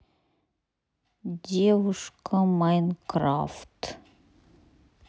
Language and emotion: Russian, sad